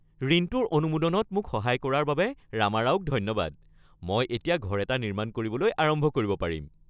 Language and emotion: Assamese, happy